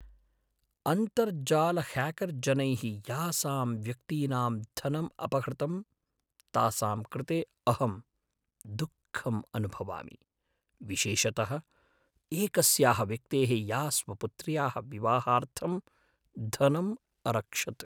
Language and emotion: Sanskrit, sad